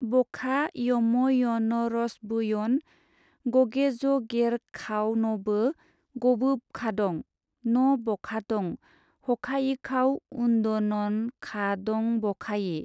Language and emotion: Bodo, neutral